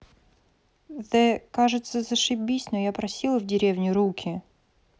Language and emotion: Russian, neutral